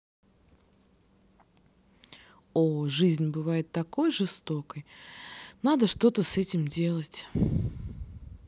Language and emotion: Russian, sad